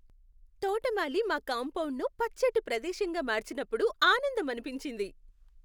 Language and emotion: Telugu, happy